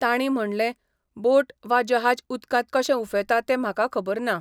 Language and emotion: Goan Konkani, neutral